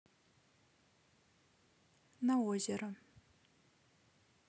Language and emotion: Russian, neutral